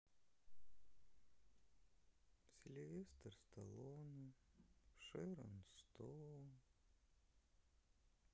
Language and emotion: Russian, sad